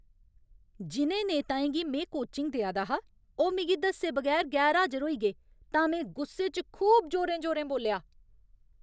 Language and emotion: Dogri, angry